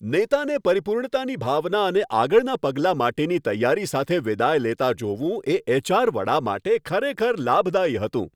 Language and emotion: Gujarati, happy